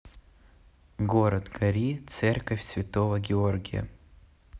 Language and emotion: Russian, neutral